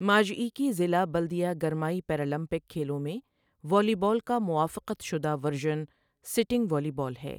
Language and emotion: Urdu, neutral